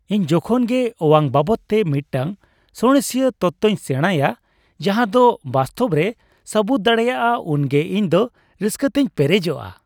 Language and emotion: Santali, happy